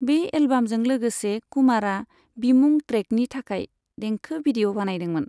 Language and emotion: Bodo, neutral